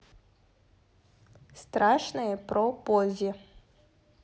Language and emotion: Russian, neutral